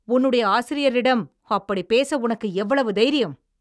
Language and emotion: Tamil, angry